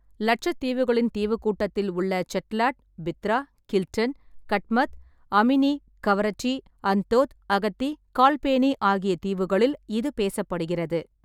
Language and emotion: Tamil, neutral